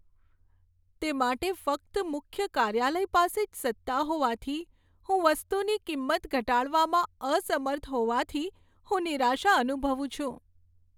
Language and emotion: Gujarati, sad